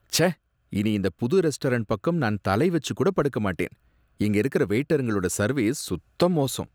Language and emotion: Tamil, disgusted